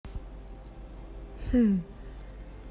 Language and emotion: Russian, neutral